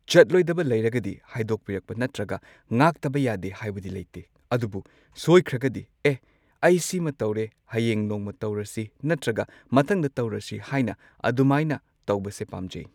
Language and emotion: Manipuri, neutral